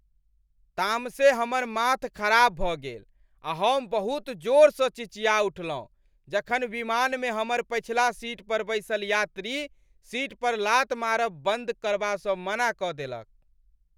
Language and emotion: Maithili, angry